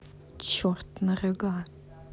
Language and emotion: Russian, angry